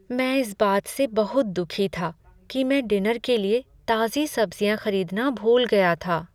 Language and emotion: Hindi, sad